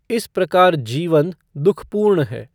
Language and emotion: Hindi, neutral